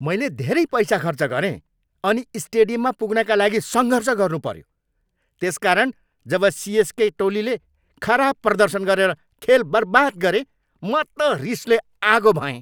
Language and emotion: Nepali, angry